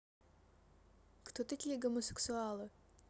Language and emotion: Russian, neutral